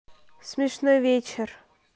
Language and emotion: Russian, neutral